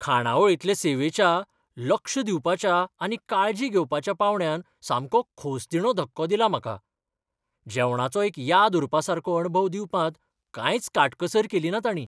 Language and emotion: Goan Konkani, surprised